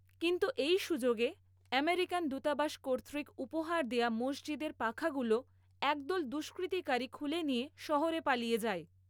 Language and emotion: Bengali, neutral